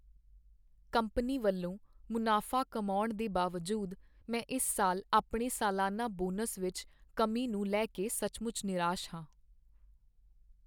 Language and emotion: Punjabi, sad